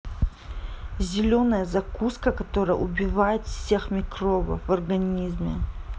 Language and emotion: Russian, angry